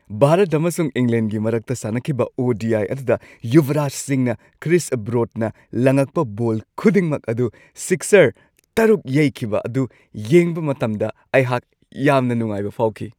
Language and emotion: Manipuri, happy